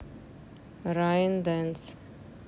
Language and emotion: Russian, neutral